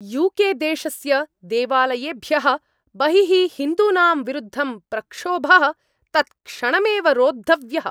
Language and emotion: Sanskrit, angry